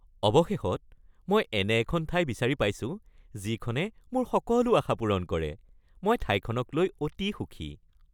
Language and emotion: Assamese, happy